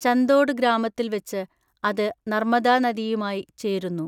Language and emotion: Malayalam, neutral